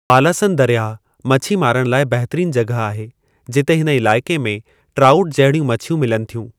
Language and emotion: Sindhi, neutral